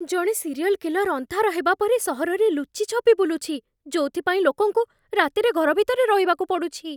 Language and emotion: Odia, fearful